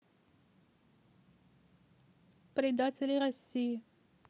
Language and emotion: Russian, neutral